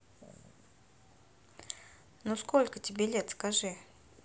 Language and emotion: Russian, neutral